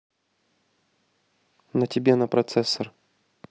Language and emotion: Russian, neutral